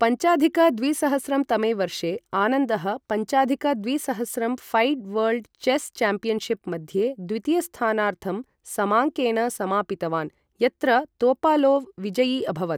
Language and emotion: Sanskrit, neutral